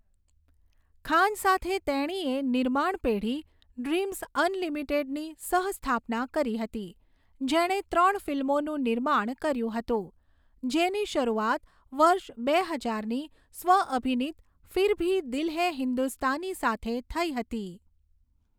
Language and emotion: Gujarati, neutral